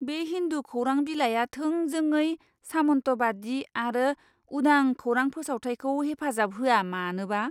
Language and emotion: Bodo, disgusted